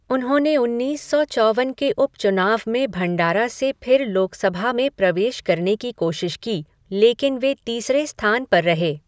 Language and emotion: Hindi, neutral